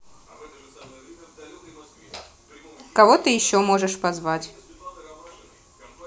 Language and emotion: Russian, neutral